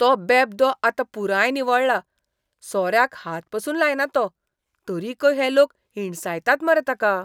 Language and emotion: Goan Konkani, disgusted